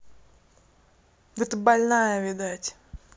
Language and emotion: Russian, angry